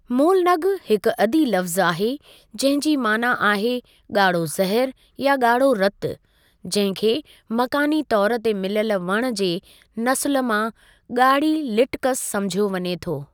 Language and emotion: Sindhi, neutral